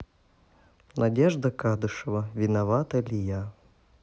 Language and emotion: Russian, neutral